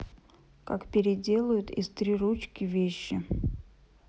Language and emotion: Russian, neutral